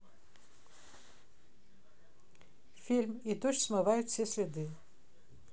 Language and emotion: Russian, neutral